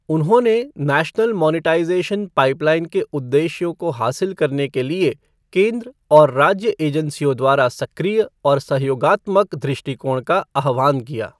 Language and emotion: Hindi, neutral